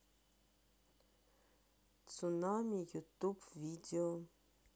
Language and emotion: Russian, neutral